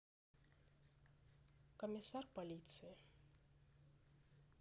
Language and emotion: Russian, neutral